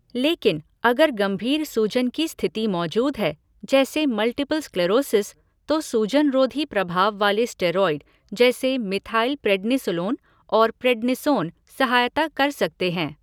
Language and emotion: Hindi, neutral